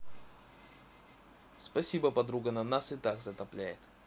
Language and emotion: Russian, neutral